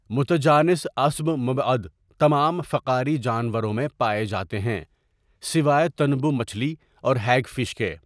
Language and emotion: Urdu, neutral